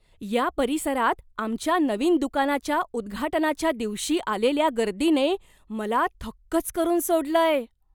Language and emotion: Marathi, surprised